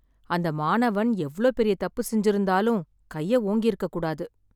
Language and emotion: Tamil, sad